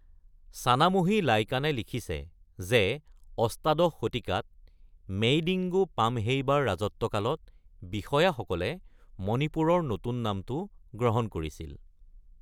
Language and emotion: Assamese, neutral